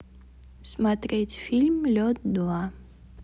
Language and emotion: Russian, neutral